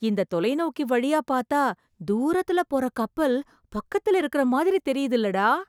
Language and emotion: Tamil, surprised